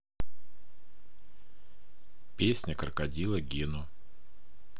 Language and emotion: Russian, neutral